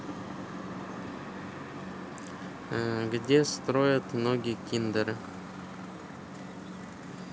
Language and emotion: Russian, neutral